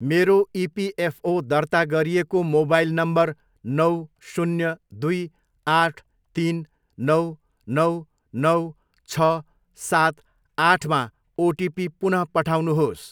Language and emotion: Nepali, neutral